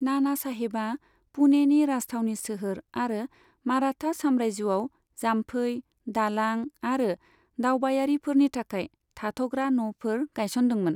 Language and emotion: Bodo, neutral